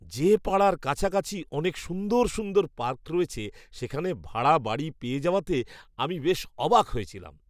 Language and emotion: Bengali, surprised